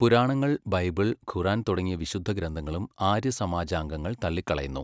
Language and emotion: Malayalam, neutral